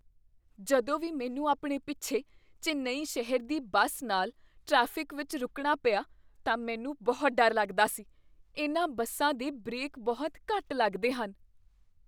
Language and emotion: Punjabi, fearful